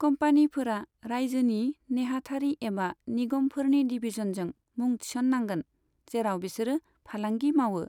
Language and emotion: Bodo, neutral